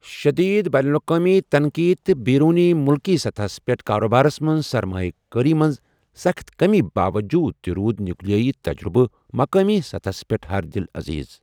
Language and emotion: Kashmiri, neutral